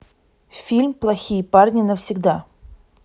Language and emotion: Russian, neutral